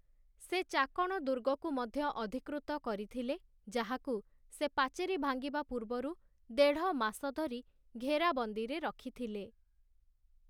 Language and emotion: Odia, neutral